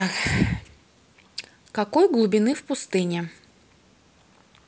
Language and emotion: Russian, neutral